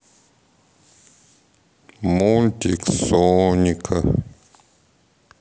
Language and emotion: Russian, sad